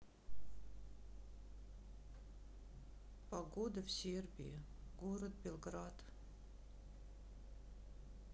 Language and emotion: Russian, sad